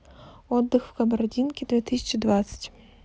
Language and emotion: Russian, neutral